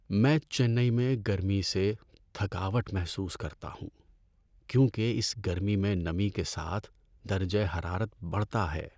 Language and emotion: Urdu, sad